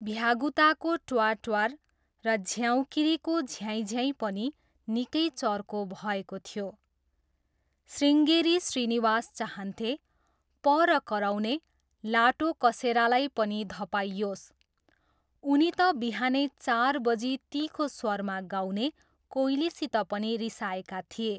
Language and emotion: Nepali, neutral